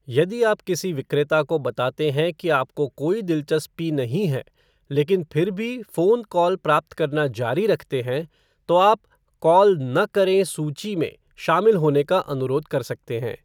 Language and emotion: Hindi, neutral